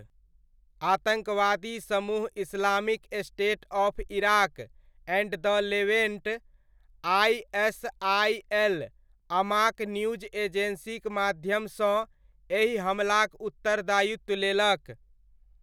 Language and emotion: Maithili, neutral